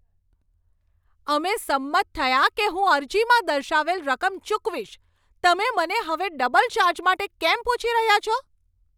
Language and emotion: Gujarati, angry